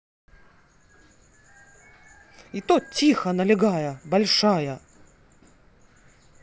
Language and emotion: Russian, angry